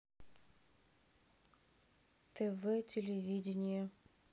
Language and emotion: Russian, neutral